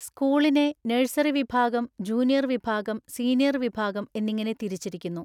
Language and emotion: Malayalam, neutral